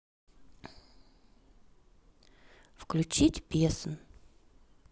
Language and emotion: Russian, neutral